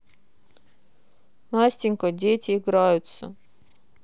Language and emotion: Russian, sad